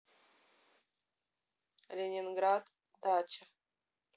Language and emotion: Russian, neutral